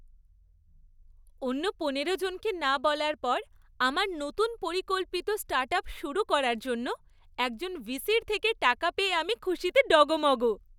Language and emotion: Bengali, happy